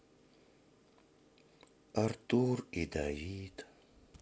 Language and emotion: Russian, sad